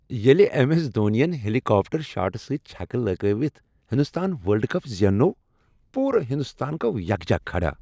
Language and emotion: Kashmiri, happy